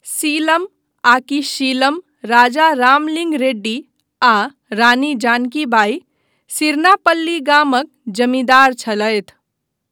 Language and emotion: Maithili, neutral